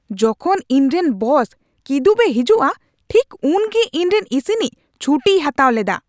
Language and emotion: Santali, angry